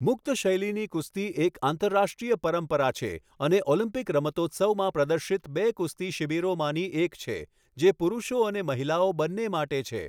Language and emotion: Gujarati, neutral